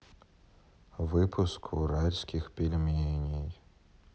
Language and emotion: Russian, sad